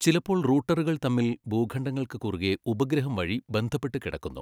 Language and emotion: Malayalam, neutral